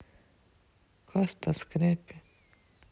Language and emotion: Russian, sad